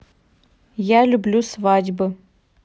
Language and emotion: Russian, neutral